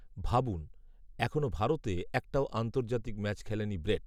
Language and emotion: Bengali, neutral